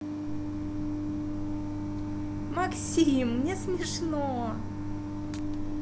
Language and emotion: Russian, positive